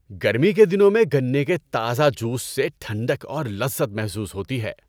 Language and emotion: Urdu, happy